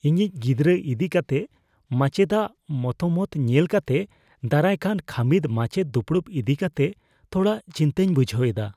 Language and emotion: Santali, fearful